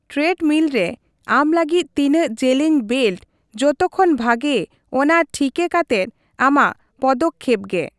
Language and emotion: Santali, neutral